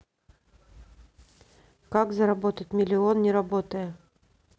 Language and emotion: Russian, neutral